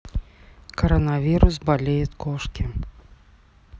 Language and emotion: Russian, neutral